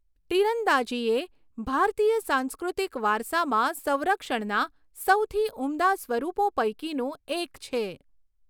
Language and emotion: Gujarati, neutral